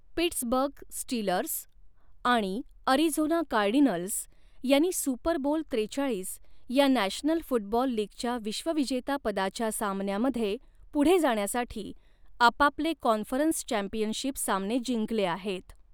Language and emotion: Marathi, neutral